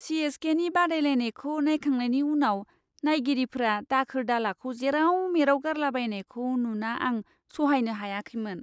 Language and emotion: Bodo, disgusted